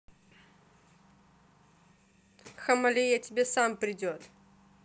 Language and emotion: Russian, neutral